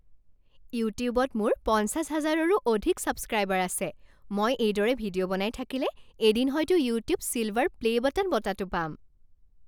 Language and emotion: Assamese, happy